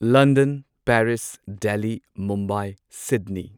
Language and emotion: Manipuri, neutral